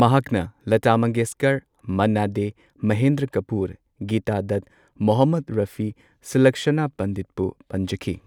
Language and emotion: Manipuri, neutral